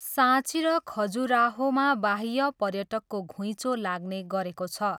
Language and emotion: Nepali, neutral